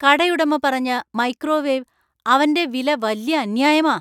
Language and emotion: Malayalam, angry